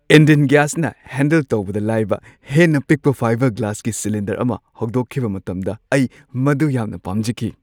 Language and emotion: Manipuri, happy